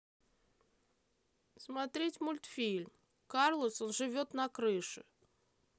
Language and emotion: Russian, neutral